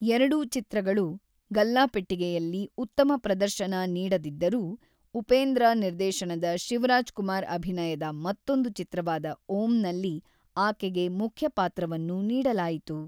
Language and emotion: Kannada, neutral